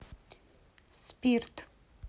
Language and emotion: Russian, neutral